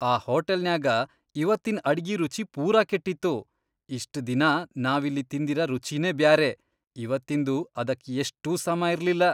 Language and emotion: Kannada, disgusted